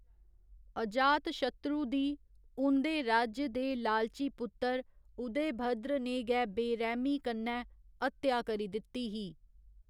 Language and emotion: Dogri, neutral